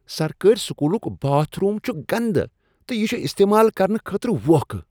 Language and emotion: Kashmiri, disgusted